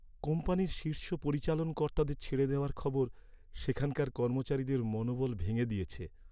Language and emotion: Bengali, sad